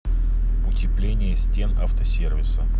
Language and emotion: Russian, neutral